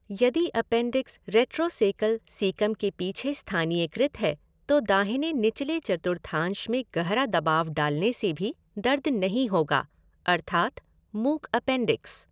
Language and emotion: Hindi, neutral